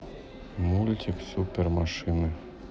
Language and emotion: Russian, neutral